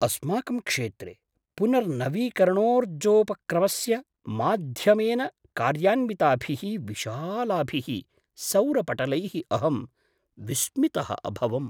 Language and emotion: Sanskrit, surprised